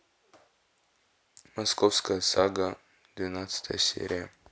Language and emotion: Russian, neutral